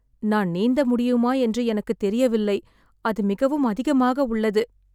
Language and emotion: Tamil, sad